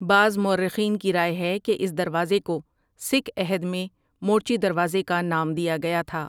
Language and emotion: Urdu, neutral